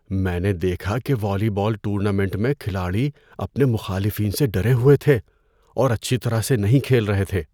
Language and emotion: Urdu, fearful